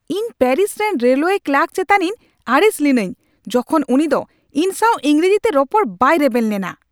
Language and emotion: Santali, angry